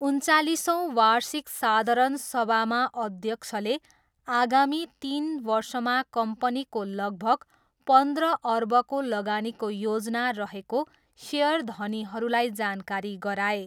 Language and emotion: Nepali, neutral